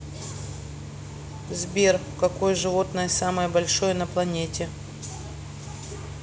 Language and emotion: Russian, neutral